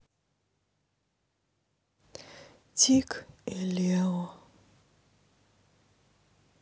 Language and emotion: Russian, sad